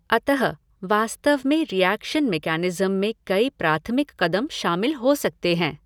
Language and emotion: Hindi, neutral